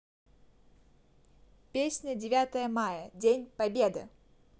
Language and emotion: Russian, positive